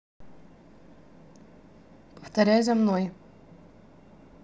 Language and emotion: Russian, neutral